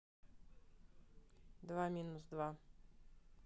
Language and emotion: Russian, neutral